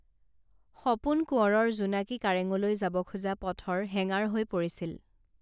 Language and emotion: Assamese, neutral